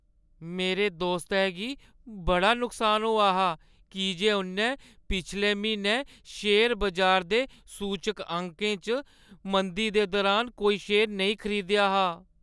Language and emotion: Dogri, sad